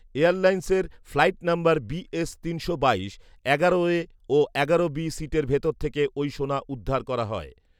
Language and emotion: Bengali, neutral